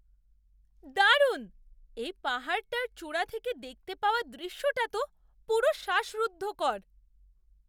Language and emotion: Bengali, surprised